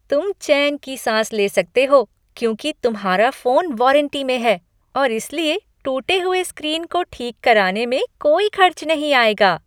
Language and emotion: Hindi, happy